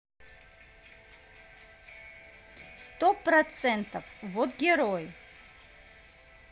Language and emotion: Russian, positive